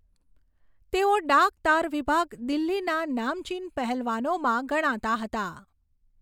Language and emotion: Gujarati, neutral